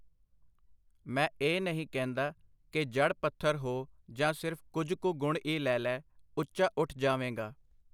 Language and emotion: Punjabi, neutral